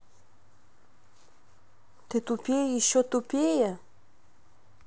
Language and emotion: Russian, angry